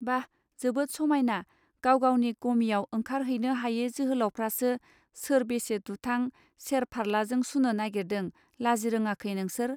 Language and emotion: Bodo, neutral